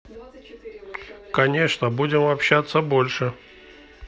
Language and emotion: Russian, neutral